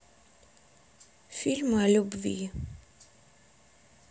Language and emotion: Russian, sad